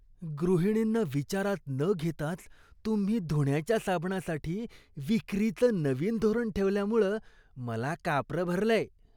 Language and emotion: Marathi, disgusted